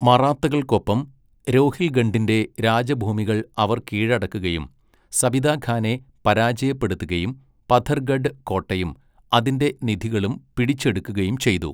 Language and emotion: Malayalam, neutral